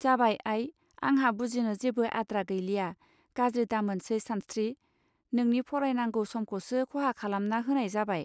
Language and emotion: Bodo, neutral